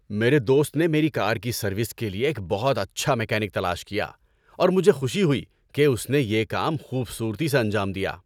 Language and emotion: Urdu, happy